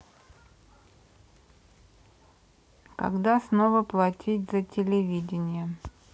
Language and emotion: Russian, neutral